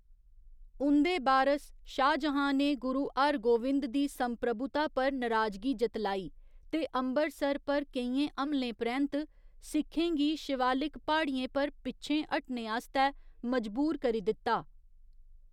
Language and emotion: Dogri, neutral